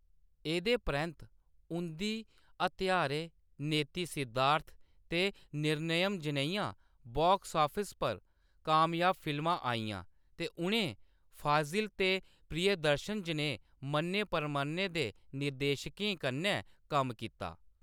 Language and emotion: Dogri, neutral